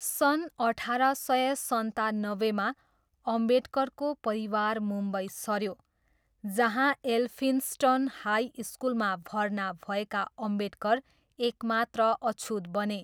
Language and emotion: Nepali, neutral